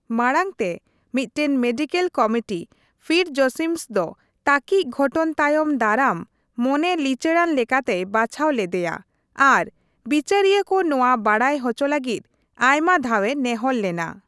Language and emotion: Santali, neutral